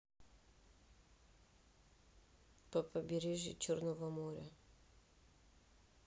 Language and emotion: Russian, neutral